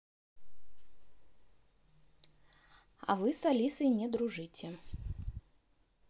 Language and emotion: Russian, neutral